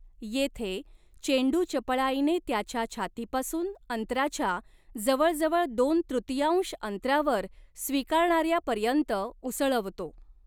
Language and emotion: Marathi, neutral